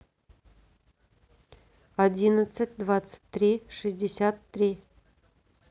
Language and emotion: Russian, neutral